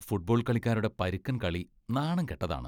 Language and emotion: Malayalam, disgusted